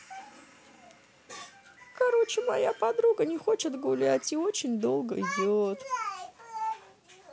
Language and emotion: Russian, sad